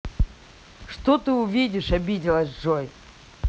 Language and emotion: Russian, angry